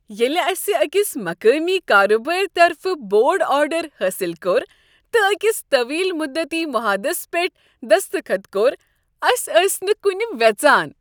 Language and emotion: Kashmiri, happy